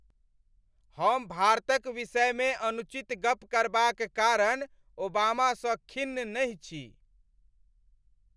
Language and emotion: Maithili, angry